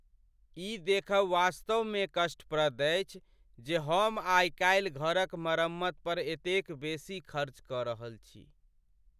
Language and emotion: Maithili, sad